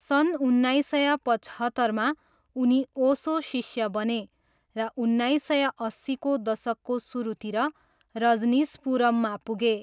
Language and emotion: Nepali, neutral